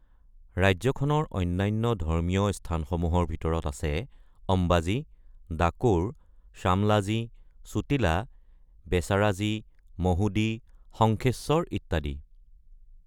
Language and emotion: Assamese, neutral